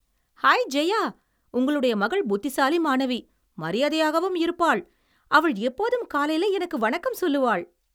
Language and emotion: Tamil, happy